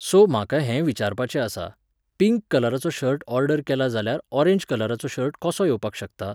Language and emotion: Goan Konkani, neutral